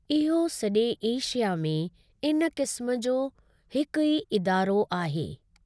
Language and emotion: Sindhi, neutral